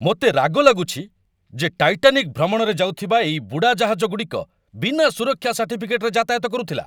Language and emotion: Odia, angry